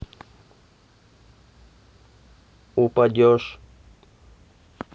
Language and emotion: Russian, neutral